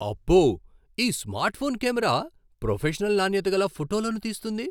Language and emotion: Telugu, surprised